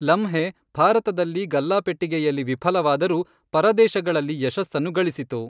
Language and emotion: Kannada, neutral